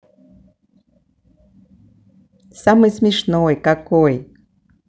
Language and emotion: Russian, positive